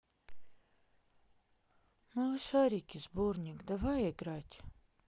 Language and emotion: Russian, sad